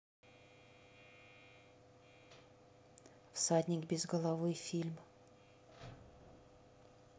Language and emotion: Russian, neutral